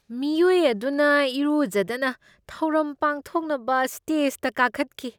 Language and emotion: Manipuri, disgusted